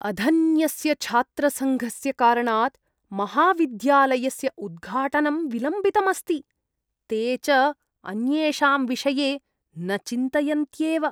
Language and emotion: Sanskrit, disgusted